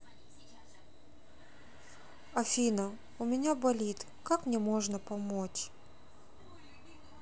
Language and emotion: Russian, sad